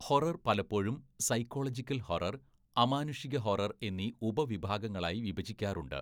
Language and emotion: Malayalam, neutral